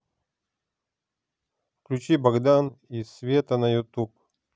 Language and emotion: Russian, neutral